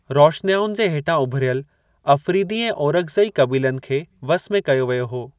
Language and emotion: Sindhi, neutral